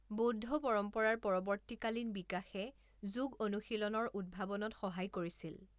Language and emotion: Assamese, neutral